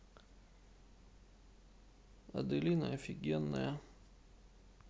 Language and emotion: Russian, sad